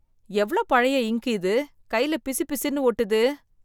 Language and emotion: Tamil, disgusted